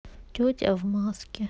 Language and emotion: Russian, sad